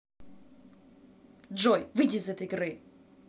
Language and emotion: Russian, angry